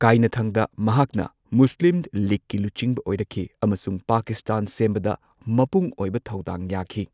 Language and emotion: Manipuri, neutral